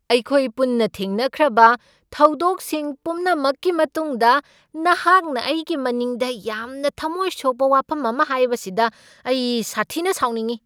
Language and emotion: Manipuri, angry